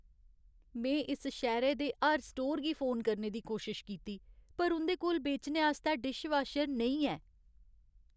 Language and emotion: Dogri, sad